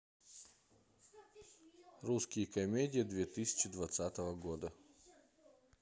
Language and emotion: Russian, neutral